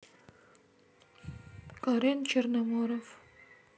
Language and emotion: Russian, sad